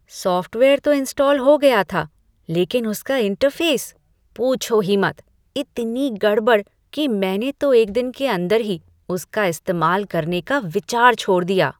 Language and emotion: Hindi, disgusted